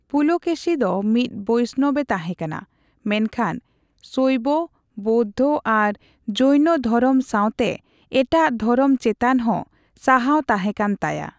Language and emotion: Santali, neutral